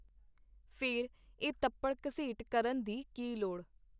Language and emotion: Punjabi, neutral